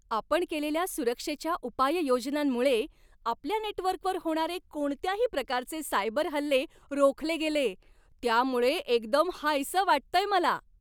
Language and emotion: Marathi, happy